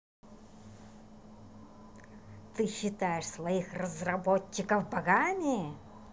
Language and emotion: Russian, angry